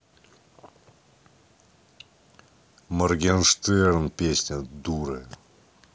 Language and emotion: Russian, neutral